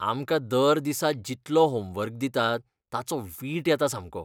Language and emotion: Goan Konkani, disgusted